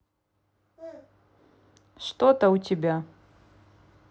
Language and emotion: Russian, neutral